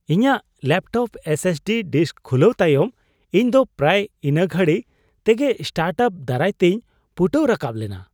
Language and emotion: Santali, surprised